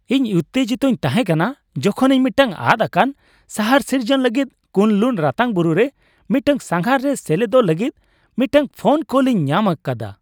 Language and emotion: Santali, happy